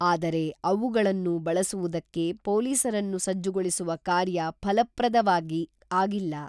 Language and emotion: Kannada, neutral